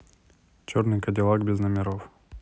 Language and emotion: Russian, neutral